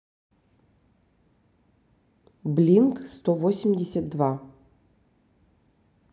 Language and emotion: Russian, neutral